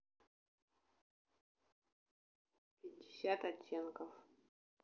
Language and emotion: Russian, neutral